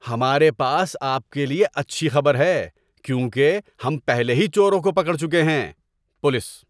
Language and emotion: Urdu, happy